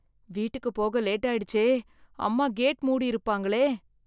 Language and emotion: Tamil, fearful